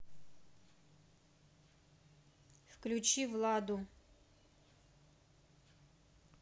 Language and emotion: Russian, neutral